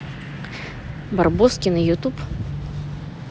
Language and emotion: Russian, neutral